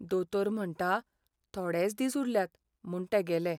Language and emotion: Goan Konkani, sad